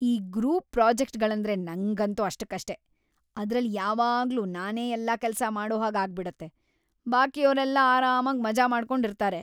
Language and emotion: Kannada, disgusted